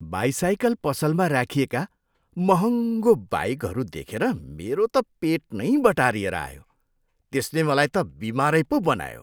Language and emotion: Nepali, disgusted